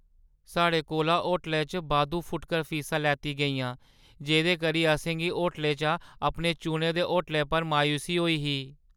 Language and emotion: Dogri, sad